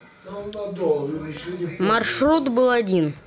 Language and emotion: Russian, neutral